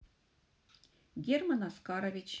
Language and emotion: Russian, neutral